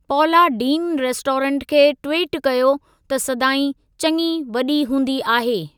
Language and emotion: Sindhi, neutral